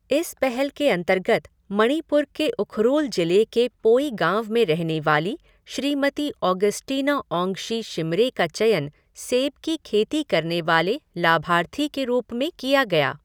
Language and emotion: Hindi, neutral